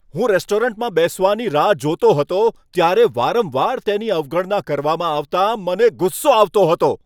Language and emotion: Gujarati, angry